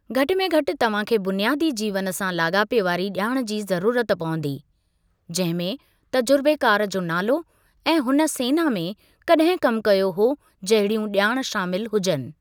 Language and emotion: Sindhi, neutral